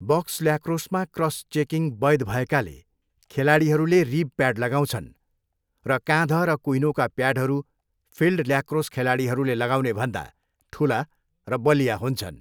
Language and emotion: Nepali, neutral